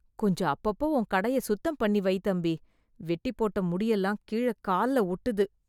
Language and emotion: Tamil, disgusted